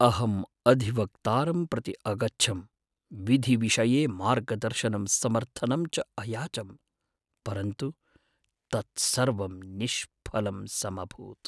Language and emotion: Sanskrit, sad